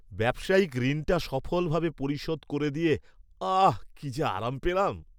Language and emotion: Bengali, happy